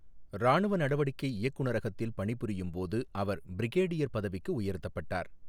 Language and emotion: Tamil, neutral